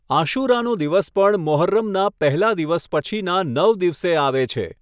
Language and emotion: Gujarati, neutral